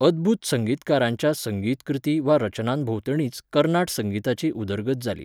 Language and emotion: Goan Konkani, neutral